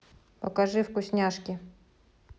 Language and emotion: Russian, neutral